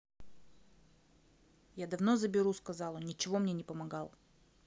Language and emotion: Russian, neutral